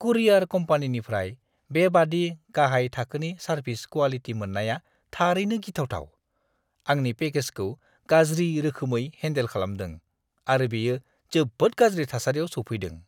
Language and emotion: Bodo, disgusted